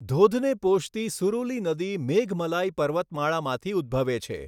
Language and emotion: Gujarati, neutral